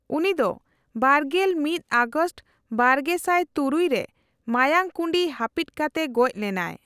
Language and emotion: Santali, neutral